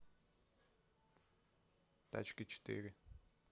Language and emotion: Russian, neutral